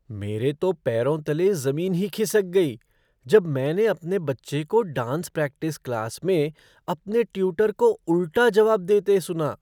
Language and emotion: Hindi, surprised